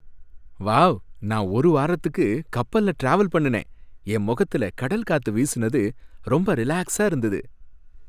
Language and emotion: Tamil, happy